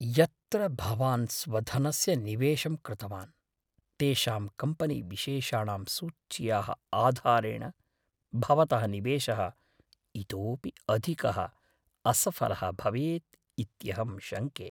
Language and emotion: Sanskrit, fearful